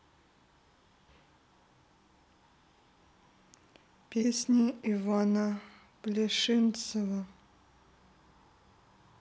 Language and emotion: Russian, sad